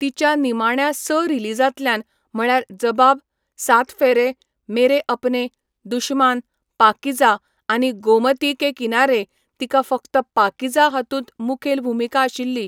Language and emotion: Goan Konkani, neutral